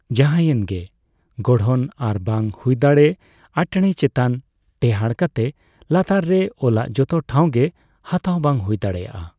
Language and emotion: Santali, neutral